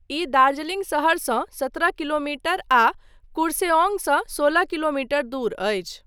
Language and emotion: Maithili, neutral